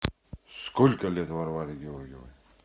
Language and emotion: Russian, neutral